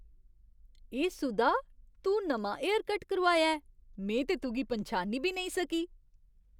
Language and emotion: Dogri, surprised